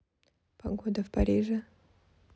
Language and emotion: Russian, neutral